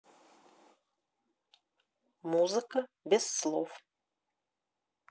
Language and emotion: Russian, neutral